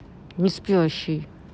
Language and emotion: Russian, angry